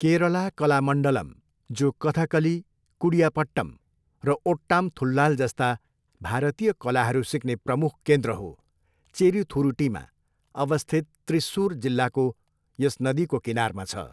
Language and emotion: Nepali, neutral